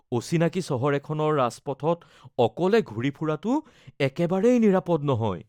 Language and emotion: Assamese, fearful